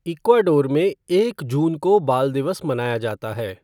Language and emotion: Hindi, neutral